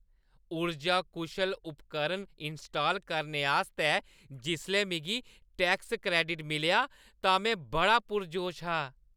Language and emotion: Dogri, happy